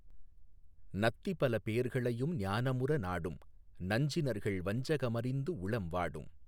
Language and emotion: Tamil, neutral